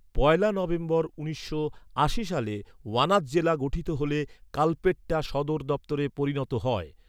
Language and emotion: Bengali, neutral